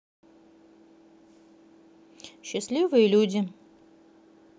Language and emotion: Russian, neutral